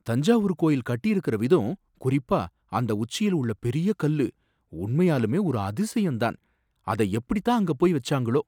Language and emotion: Tamil, surprised